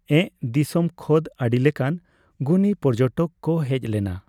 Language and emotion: Santali, neutral